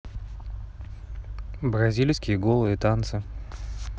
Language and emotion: Russian, neutral